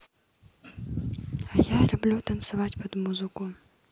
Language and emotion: Russian, neutral